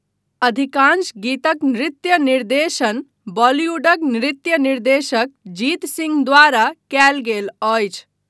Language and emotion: Maithili, neutral